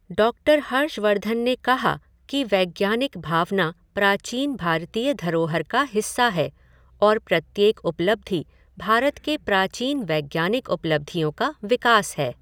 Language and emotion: Hindi, neutral